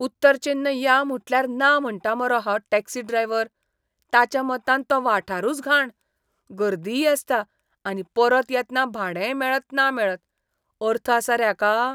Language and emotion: Goan Konkani, disgusted